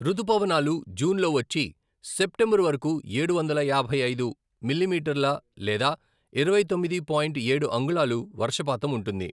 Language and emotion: Telugu, neutral